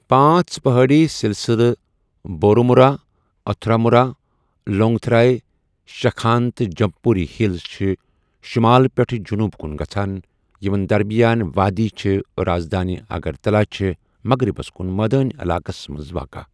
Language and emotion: Kashmiri, neutral